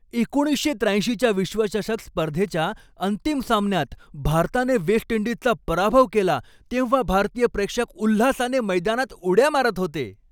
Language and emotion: Marathi, happy